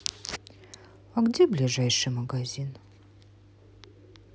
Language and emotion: Russian, sad